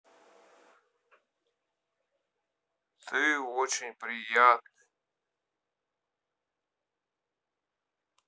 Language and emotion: Russian, neutral